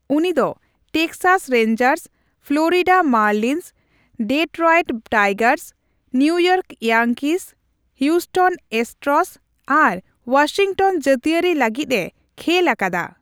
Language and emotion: Santali, neutral